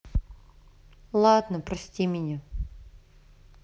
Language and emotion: Russian, sad